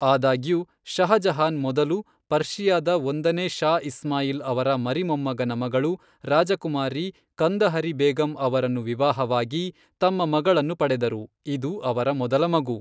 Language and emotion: Kannada, neutral